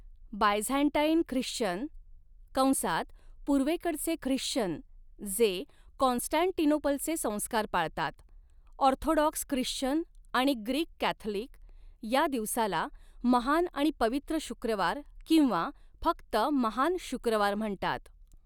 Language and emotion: Marathi, neutral